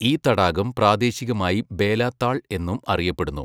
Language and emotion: Malayalam, neutral